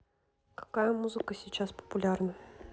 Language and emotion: Russian, neutral